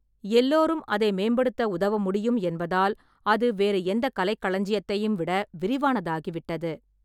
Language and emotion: Tamil, neutral